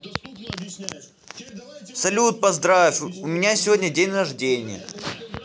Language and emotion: Russian, positive